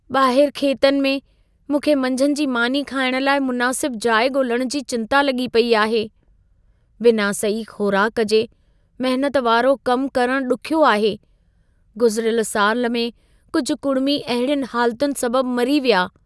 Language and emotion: Sindhi, fearful